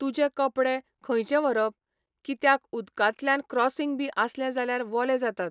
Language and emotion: Goan Konkani, neutral